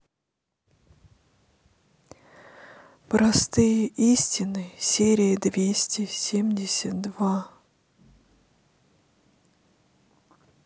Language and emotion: Russian, sad